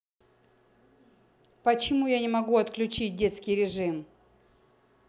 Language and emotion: Russian, angry